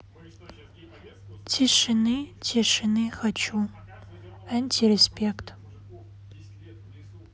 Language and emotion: Russian, sad